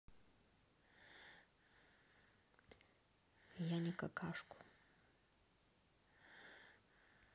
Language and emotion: Russian, neutral